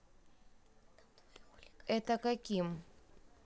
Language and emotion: Russian, neutral